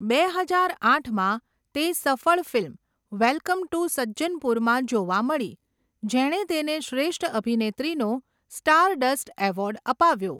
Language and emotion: Gujarati, neutral